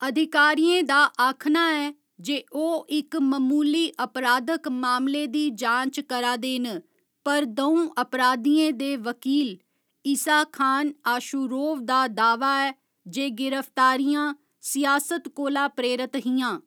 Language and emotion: Dogri, neutral